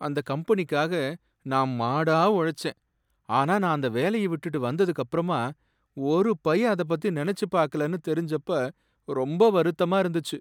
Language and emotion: Tamil, sad